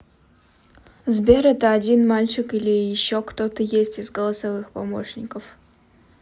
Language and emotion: Russian, neutral